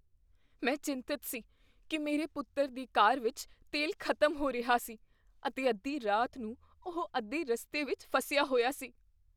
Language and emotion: Punjabi, fearful